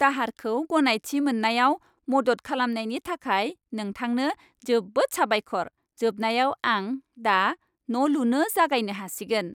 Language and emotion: Bodo, happy